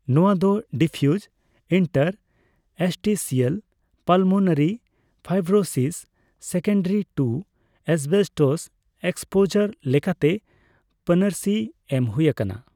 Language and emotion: Santali, neutral